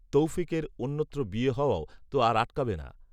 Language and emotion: Bengali, neutral